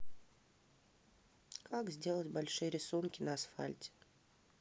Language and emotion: Russian, neutral